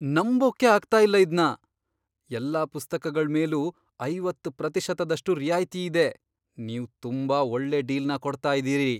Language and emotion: Kannada, surprised